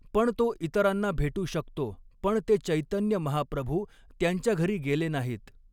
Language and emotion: Marathi, neutral